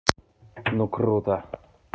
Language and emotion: Russian, positive